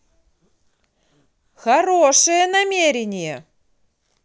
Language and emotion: Russian, positive